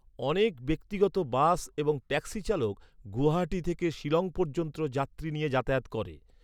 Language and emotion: Bengali, neutral